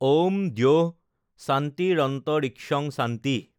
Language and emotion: Assamese, neutral